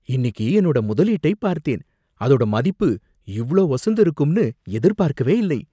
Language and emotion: Tamil, surprised